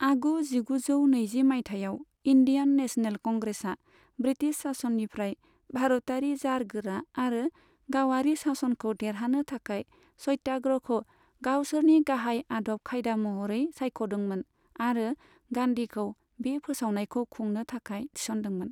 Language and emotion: Bodo, neutral